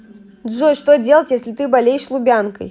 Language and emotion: Russian, neutral